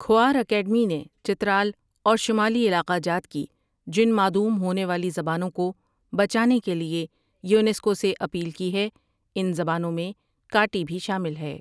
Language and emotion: Urdu, neutral